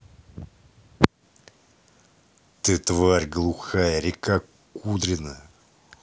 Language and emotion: Russian, angry